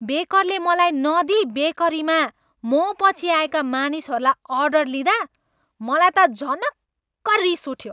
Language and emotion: Nepali, angry